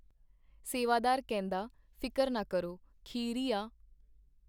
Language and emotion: Punjabi, neutral